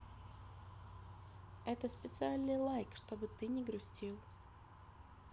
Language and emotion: Russian, neutral